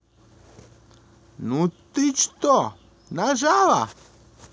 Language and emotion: Russian, positive